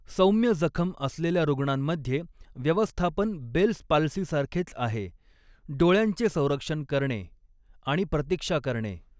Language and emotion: Marathi, neutral